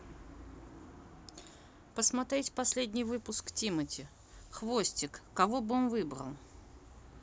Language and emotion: Russian, neutral